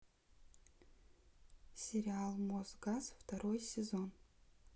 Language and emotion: Russian, neutral